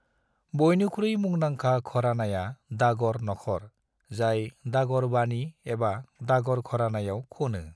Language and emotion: Bodo, neutral